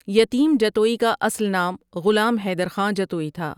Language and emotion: Urdu, neutral